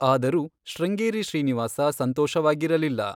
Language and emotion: Kannada, neutral